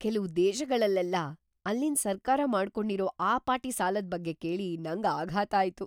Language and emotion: Kannada, surprised